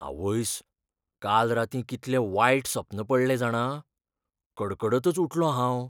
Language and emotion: Goan Konkani, fearful